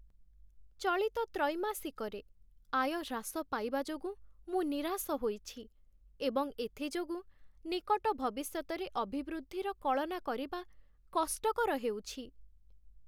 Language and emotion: Odia, sad